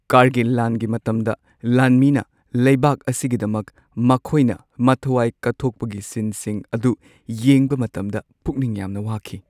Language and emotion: Manipuri, sad